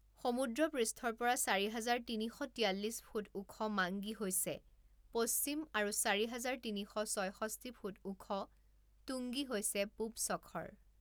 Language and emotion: Assamese, neutral